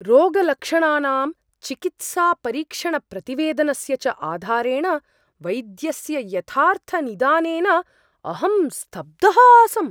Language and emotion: Sanskrit, surprised